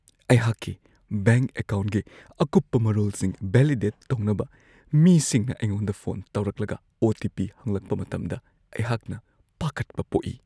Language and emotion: Manipuri, fearful